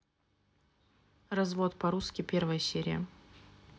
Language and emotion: Russian, neutral